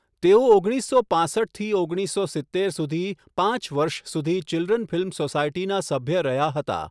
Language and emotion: Gujarati, neutral